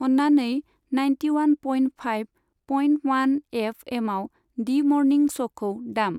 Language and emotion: Bodo, neutral